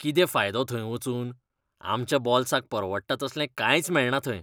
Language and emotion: Goan Konkani, disgusted